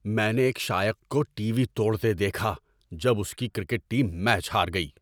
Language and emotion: Urdu, angry